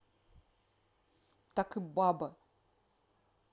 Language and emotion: Russian, angry